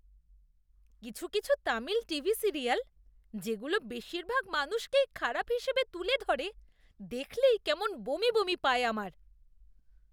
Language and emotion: Bengali, disgusted